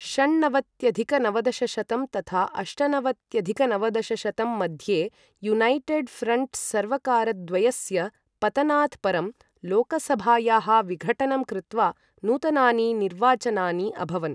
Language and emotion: Sanskrit, neutral